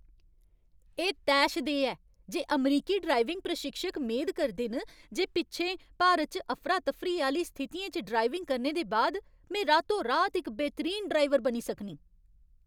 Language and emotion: Dogri, angry